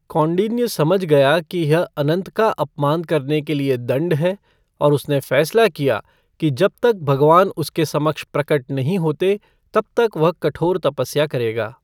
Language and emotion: Hindi, neutral